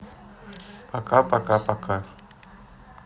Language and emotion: Russian, neutral